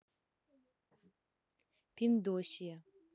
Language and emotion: Russian, neutral